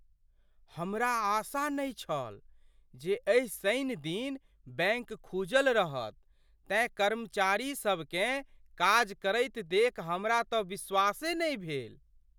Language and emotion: Maithili, surprised